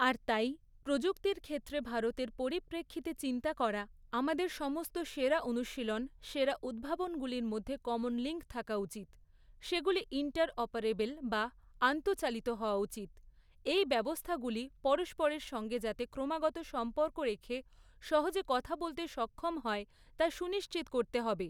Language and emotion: Bengali, neutral